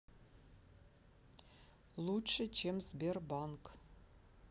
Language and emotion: Russian, neutral